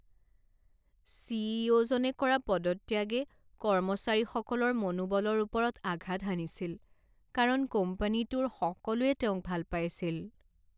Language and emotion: Assamese, sad